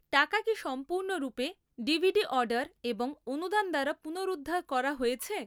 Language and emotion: Bengali, neutral